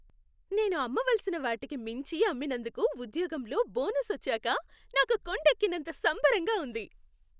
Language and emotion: Telugu, happy